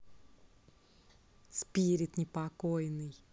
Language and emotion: Russian, neutral